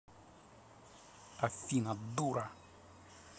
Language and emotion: Russian, angry